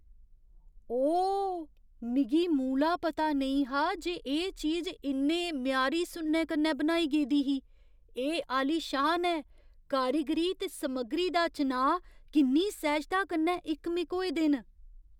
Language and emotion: Dogri, surprised